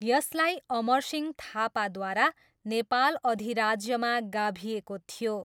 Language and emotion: Nepali, neutral